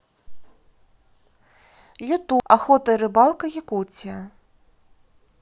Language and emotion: Russian, neutral